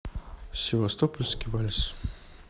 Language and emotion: Russian, neutral